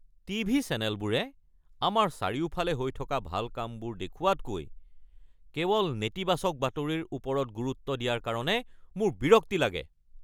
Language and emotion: Assamese, angry